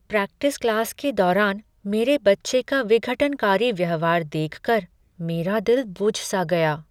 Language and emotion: Hindi, sad